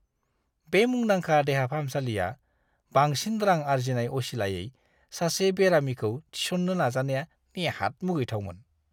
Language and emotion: Bodo, disgusted